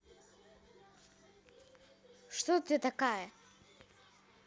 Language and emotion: Russian, neutral